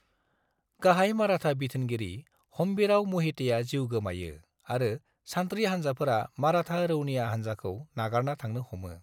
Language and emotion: Bodo, neutral